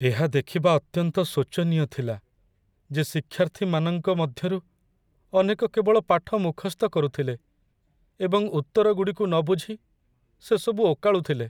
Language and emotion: Odia, sad